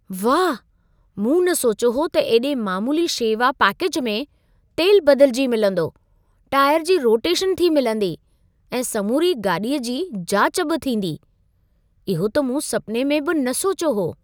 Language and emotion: Sindhi, surprised